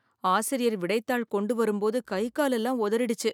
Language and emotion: Tamil, fearful